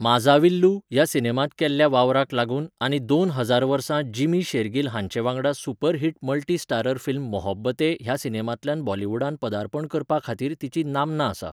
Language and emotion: Goan Konkani, neutral